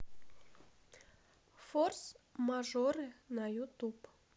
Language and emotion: Russian, neutral